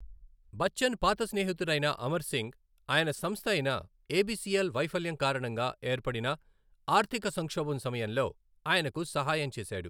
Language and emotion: Telugu, neutral